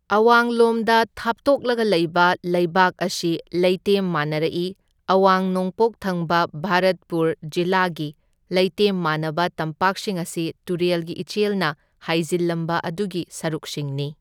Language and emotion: Manipuri, neutral